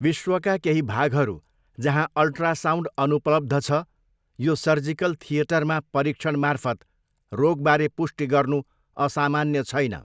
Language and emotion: Nepali, neutral